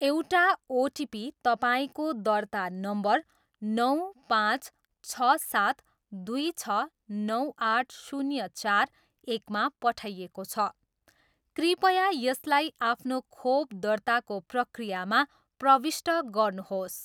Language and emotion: Nepali, neutral